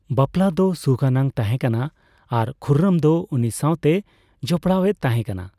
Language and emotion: Santali, neutral